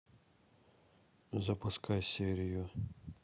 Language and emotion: Russian, neutral